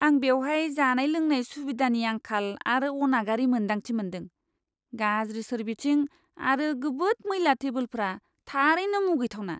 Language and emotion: Bodo, disgusted